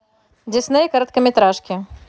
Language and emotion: Russian, neutral